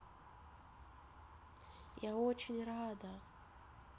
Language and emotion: Russian, sad